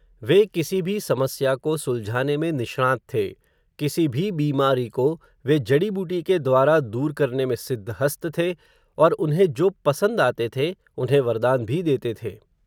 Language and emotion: Hindi, neutral